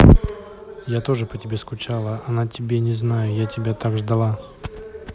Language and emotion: Russian, neutral